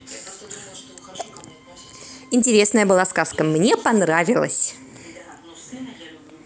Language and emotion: Russian, positive